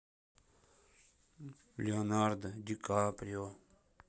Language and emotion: Russian, sad